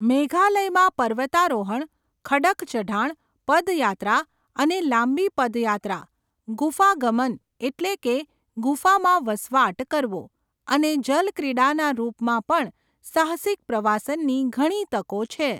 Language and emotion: Gujarati, neutral